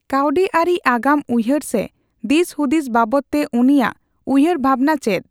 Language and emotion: Santali, neutral